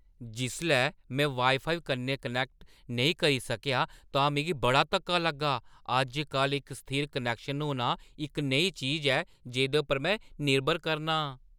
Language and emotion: Dogri, surprised